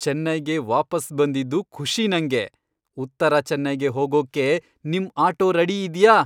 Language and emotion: Kannada, happy